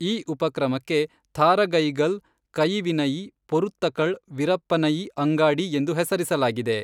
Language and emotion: Kannada, neutral